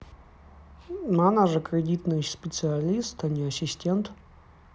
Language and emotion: Russian, neutral